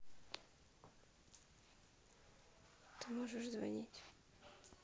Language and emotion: Russian, sad